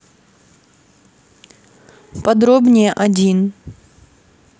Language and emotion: Russian, neutral